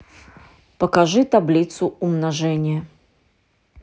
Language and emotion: Russian, neutral